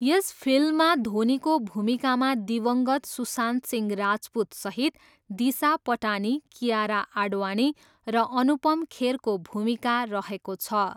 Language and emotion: Nepali, neutral